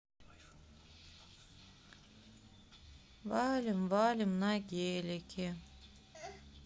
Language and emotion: Russian, sad